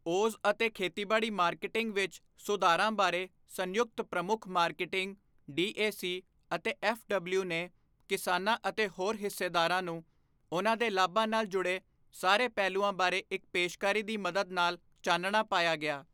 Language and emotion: Punjabi, neutral